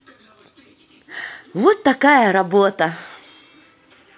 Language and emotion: Russian, positive